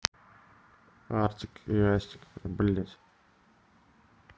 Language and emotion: Russian, neutral